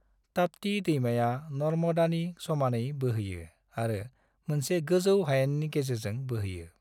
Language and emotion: Bodo, neutral